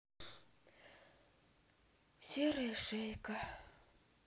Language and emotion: Russian, sad